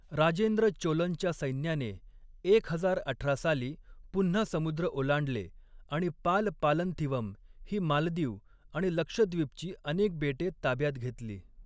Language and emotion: Marathi, neutral